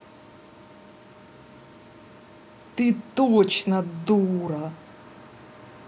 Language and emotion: Russian, angry